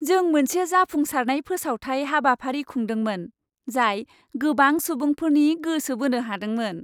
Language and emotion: Bodo, happy